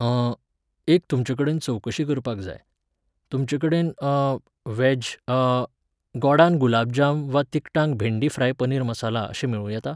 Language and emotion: Goan Konkani, neutral